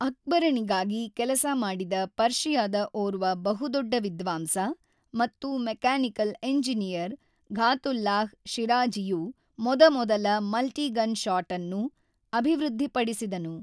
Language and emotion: Kannada, neutral